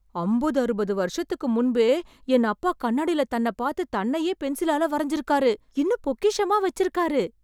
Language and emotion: Tamil, surprised